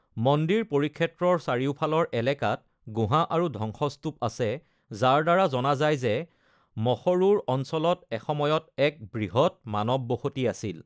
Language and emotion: Assamese, neutral